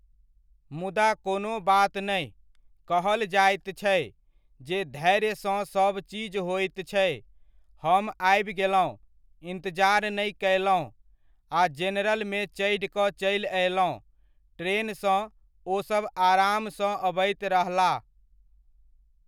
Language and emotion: Maithili, neutral